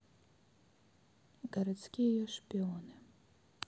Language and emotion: Russian, neutral